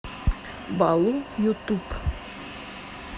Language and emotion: Russian, neutral